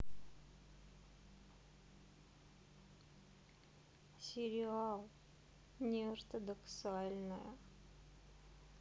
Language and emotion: Russian, sad